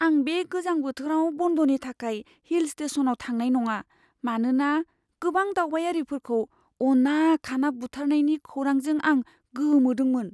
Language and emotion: Bodo, fearful